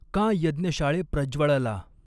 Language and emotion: Marathi, neutral